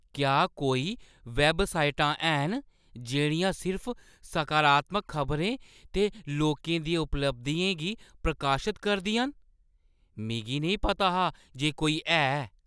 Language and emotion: Dogri, surprised